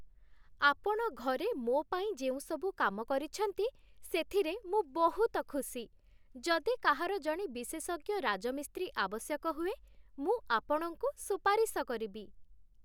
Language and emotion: Odia, happy